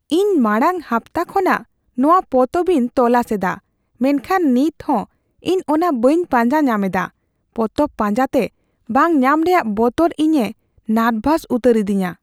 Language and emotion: Santali, fearful